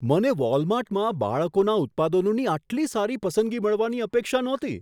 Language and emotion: Gujarati, surprised